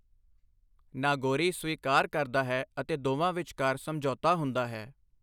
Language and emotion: Punjabi, neutral